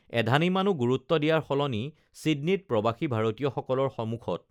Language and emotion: Assamese, neutral